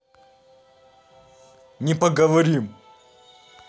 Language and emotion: Russian, angry